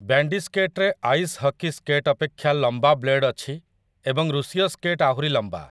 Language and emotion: Odia, neutral